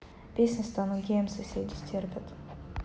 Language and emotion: Russian, neutral